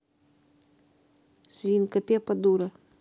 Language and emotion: Russian, neutral